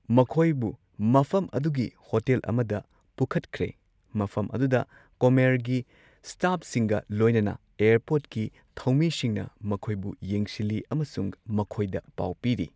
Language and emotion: Manipuri, neutral